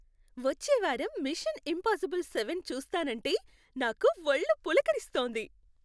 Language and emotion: Telugu, happy